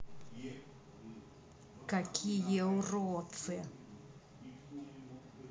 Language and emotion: Russian, angry